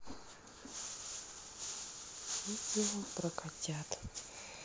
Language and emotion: Russian, sad